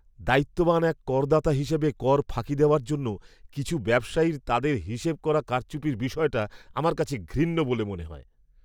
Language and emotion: Bengali, disgusted